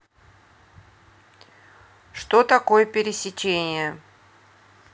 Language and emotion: Russian, neutral